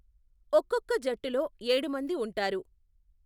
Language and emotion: Telugu, neutral